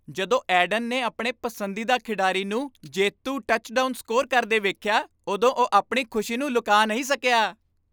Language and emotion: Punjabi, happy